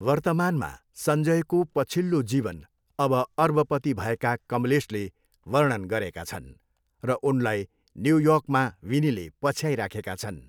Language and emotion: Nepali, neutral